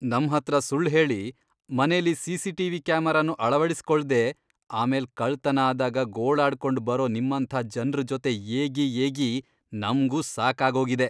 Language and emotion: Kannada, disgusted